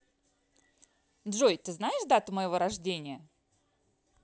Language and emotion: Russian, positive